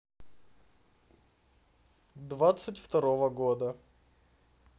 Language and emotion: Russian, neutral